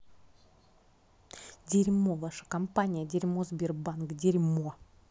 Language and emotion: Russian, angry